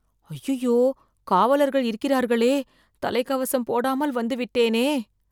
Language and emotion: Tamil, fearful